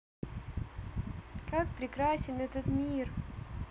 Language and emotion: Russian, positive